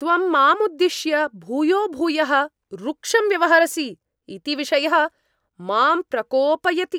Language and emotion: Sanskrit, angry